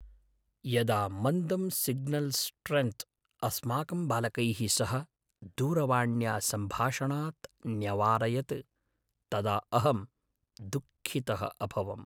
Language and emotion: Sanskrit, sad